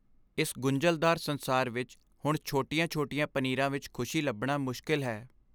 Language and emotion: Punjabi, sad